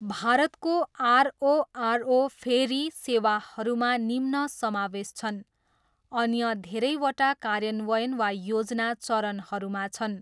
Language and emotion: Nepali, neutral